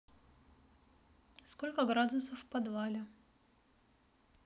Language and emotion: Russian, neutral